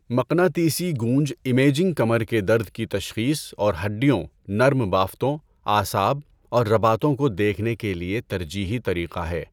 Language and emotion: Urdu, neutral